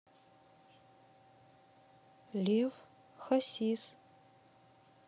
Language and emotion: Russian, neutral